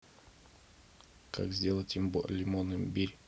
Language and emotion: Russian, neutral